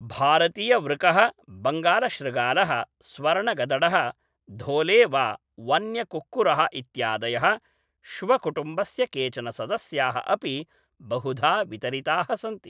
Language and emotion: Sanskrit, neutral